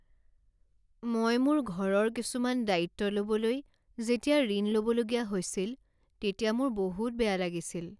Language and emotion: Assamese, sad